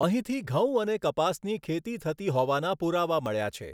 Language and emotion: Gujarati, neutral